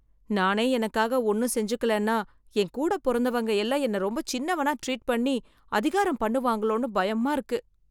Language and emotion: Tamil, fearful